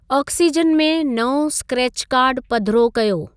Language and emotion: Sindhi, neutral